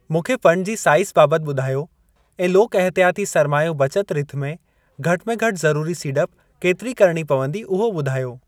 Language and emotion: Sindhi, neutral